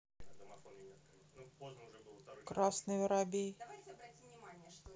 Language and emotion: Russian, neutral